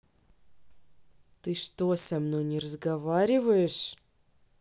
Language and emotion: Russian, angry